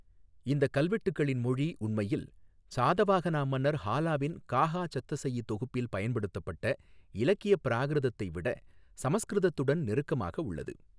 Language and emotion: Tamil, neutral